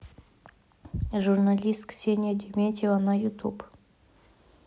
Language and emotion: Russian, neutral